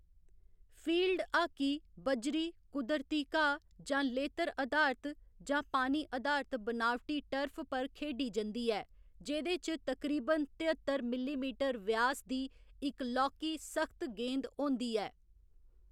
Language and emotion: Dogri, neutral